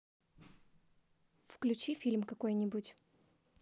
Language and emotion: Russian, neutral